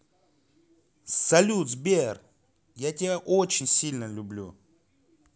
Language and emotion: Russian, positive